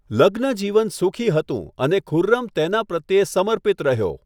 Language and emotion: Gujarati, neutral